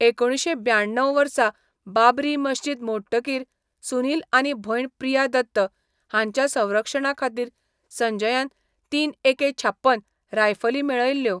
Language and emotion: Goan Konkani, neutral